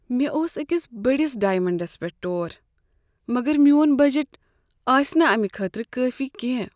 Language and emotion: Kashmiri, sad